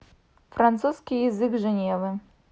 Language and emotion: Russian, neutral